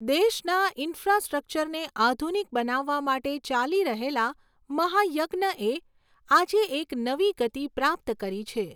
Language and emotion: Gujarati, neutral